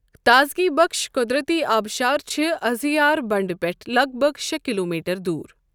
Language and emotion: Kashmiri, neutral